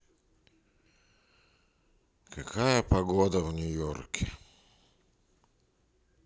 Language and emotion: Russian, sad